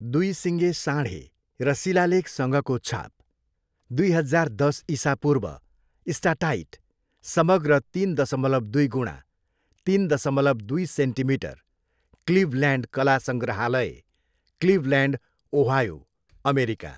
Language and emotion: Nepali, neutral